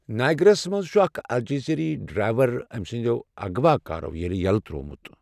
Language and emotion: Kashmiri, neutral